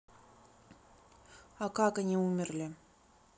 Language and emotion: Russian, neutral